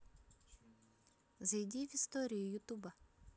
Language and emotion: Russian, positive